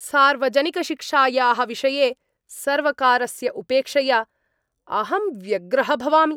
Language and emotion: Sanskrit, angry